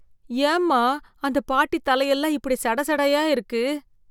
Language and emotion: Tamil, disgusted